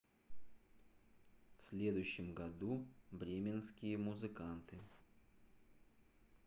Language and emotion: Russian, neutral